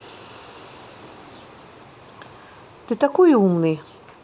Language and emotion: Russian, neutral